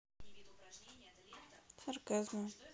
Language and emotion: Russian, neutral